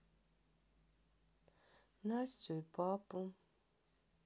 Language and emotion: Russian, sad